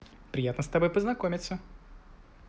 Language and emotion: Russian, positive